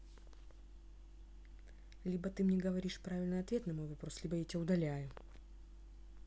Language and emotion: Russian, angry